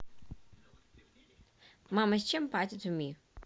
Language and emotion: Russian, neutral